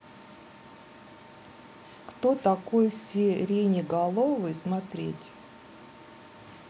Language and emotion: Russian, neutral